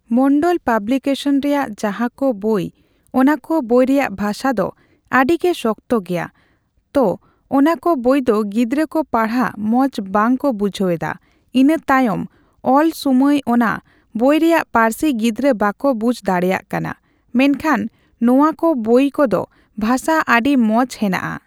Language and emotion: Santali, neutral